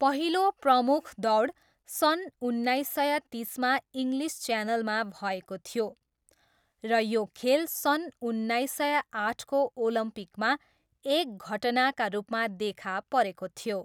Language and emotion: Nepali, neutral